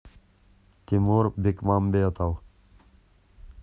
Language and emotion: Russian, neutral